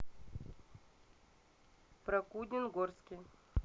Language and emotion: Russian, neutral